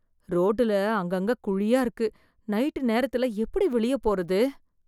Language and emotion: Tamil, fearful